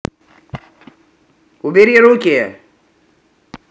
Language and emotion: Russian, angry